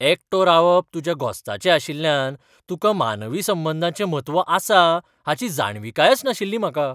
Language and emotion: Goan Konkani, surprised